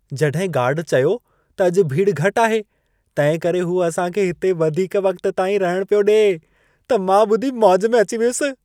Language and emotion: Sindhi, happy